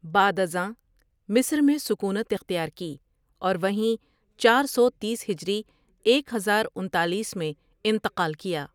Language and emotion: Urdu, neutral